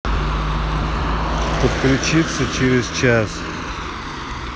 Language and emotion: Russian, neutral